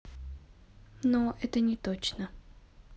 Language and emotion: Russian, neutral